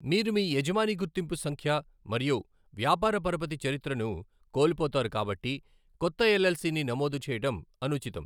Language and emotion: Telugu, neutral